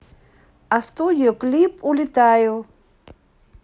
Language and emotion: Russian, neutral